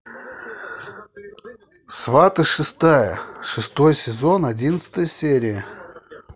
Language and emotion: Russian, neutral